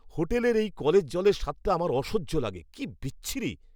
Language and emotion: Bengali, disgusted